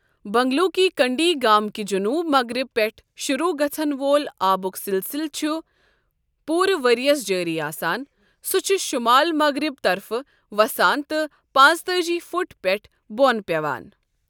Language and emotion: Kashmiri, neutral